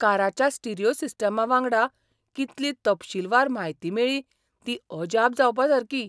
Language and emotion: Goan Konkani, surprised